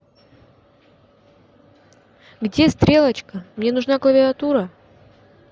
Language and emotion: Russian, angry